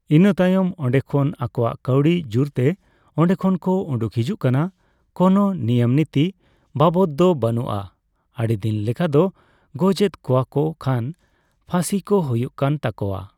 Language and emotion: Santali, neutral